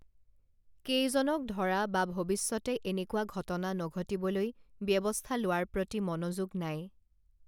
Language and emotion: Assamese, neutral